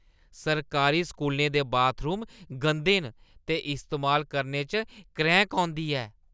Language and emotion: Dogri, disgusted